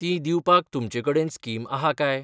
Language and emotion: Goan Konkani, neutral